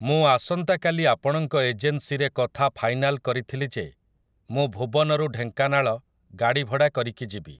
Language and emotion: Odia, neutral